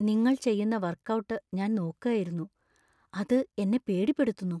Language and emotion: Malayalam, fearful